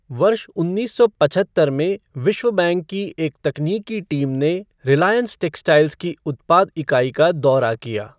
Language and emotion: Hindi, neutral